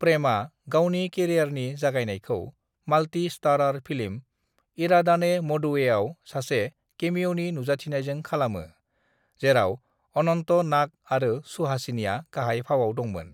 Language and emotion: Bodo, neutral